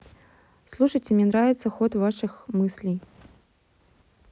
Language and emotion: Russian, neutral